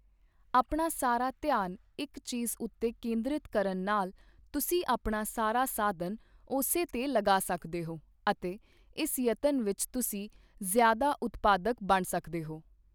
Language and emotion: Punjabi, neutral